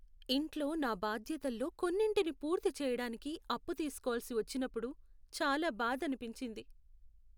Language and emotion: Telugu, sad